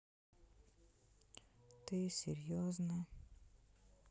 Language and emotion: Russian, sad